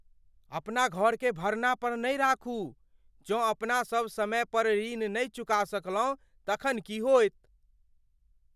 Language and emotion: Maithili, fearful